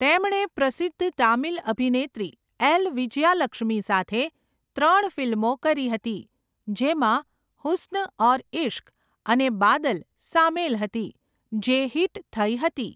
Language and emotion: Gujarati, neutral